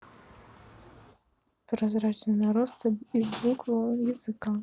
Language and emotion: Russian, neutral